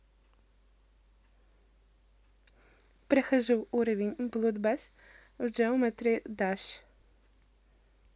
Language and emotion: Russian, positive